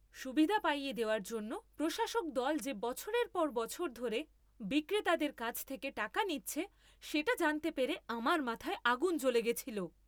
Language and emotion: Bengali, angry